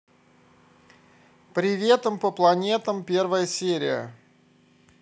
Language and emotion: Russian, positive